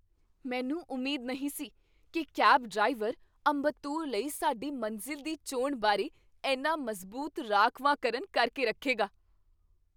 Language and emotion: Punjabi, surprised